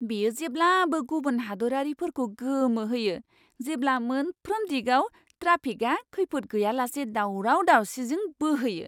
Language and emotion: Bodo, surprised